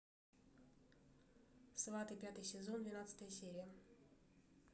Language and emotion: Russian, neutral